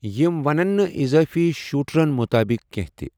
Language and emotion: Kashmiri, neutral